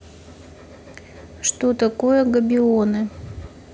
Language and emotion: Russian, neutral